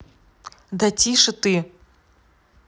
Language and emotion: Russian, angry